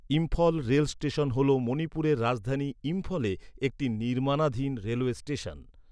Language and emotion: Bengali, neutral